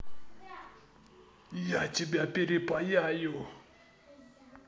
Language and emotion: Russian, angry